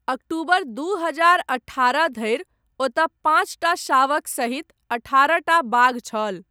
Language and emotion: Maithili, neutral